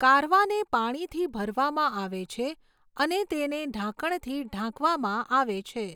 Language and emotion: Gujarati, neutral